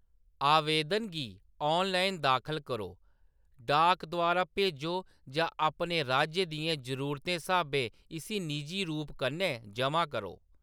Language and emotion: Dogri, neutral